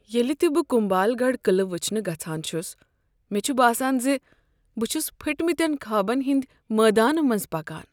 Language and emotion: Kashmiri, sad